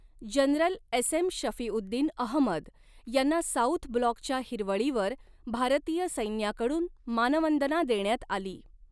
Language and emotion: Marathi, neutral